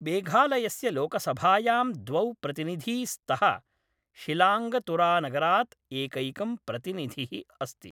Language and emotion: Sanskrit, neutral